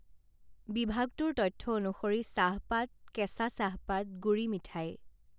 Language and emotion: Assamese, neutral